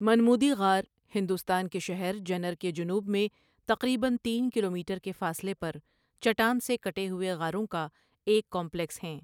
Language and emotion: Urdu, neutral